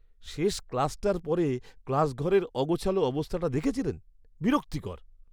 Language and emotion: Bengali, disgusted